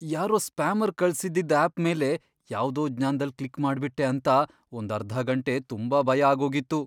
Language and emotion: Kannada, fearful